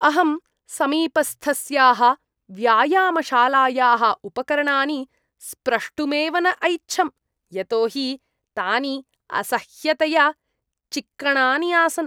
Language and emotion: Sanskrit, disgusted